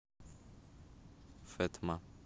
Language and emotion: Russian, neutral